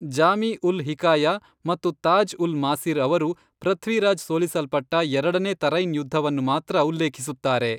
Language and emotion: Kannada, neutral